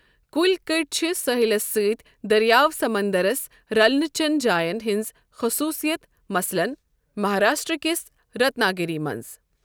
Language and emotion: Kashmiri, neutral